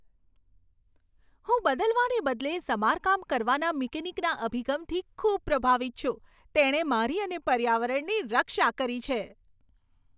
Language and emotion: Gujarati, happy